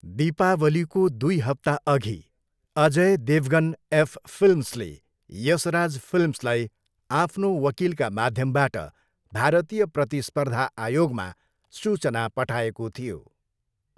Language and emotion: Nepali, neutral